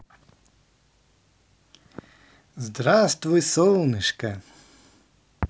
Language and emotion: Russian, positive